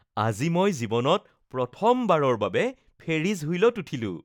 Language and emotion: Assamese, happy